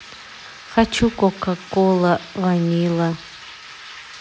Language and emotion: Russian, neutral